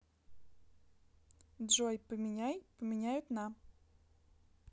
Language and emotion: Russian, neutral